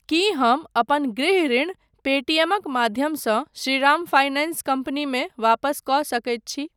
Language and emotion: Maithili, neutral